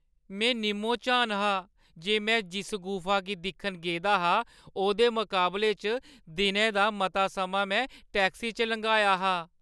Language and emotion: Dogri, sad